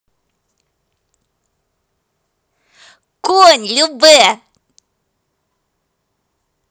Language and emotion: Russian, positive